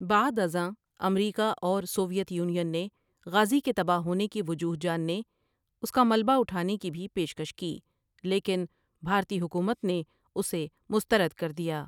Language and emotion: Urdu, neutral